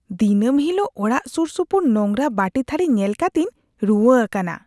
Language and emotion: Santali, disgusted